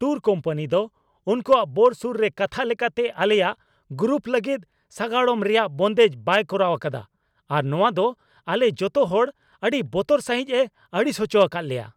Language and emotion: Santali, angry